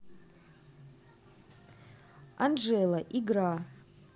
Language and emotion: Russian, neutral